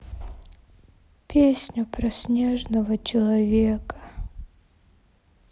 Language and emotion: Russian, sad